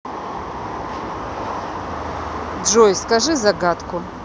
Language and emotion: Russian, neutral